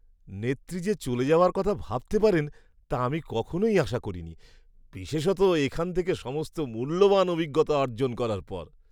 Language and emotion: Bengali, surprised